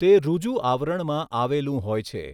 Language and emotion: Gujarati, neutral